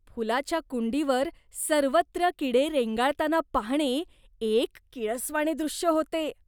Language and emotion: Marathi, disgusted